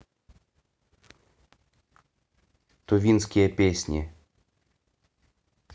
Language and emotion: Russian, neutral